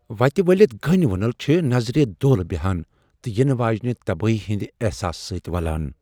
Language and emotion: Kashmiri, fearful